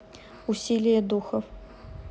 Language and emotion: Russian, neutral